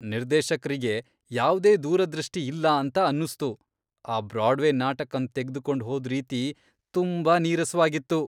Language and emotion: Kannada, disgusted